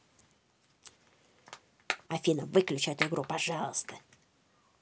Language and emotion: Russian, angry